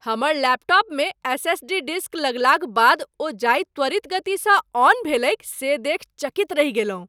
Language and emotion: Maithili, surprised